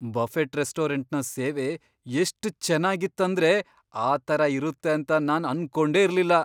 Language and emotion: Kannada, surprised